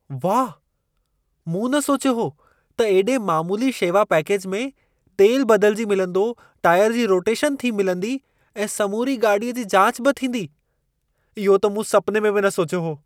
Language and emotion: Sindhi, surprised